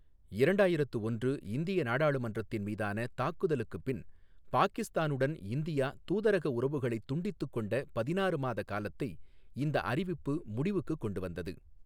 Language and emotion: Tamil, neutral